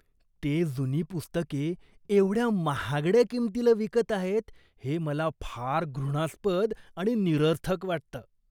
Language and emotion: Marathi, disgusted